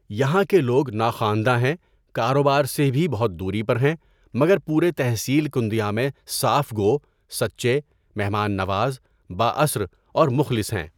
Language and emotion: Urdu, neutral